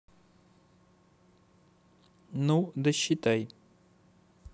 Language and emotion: Russian, neutral